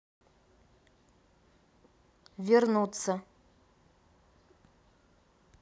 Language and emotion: Russian, neutral